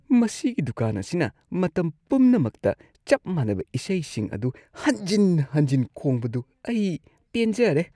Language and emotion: Manipuri, disgusted